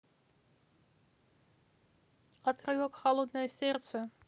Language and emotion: Russian, neutral